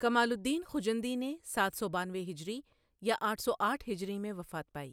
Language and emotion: Urdu, neutral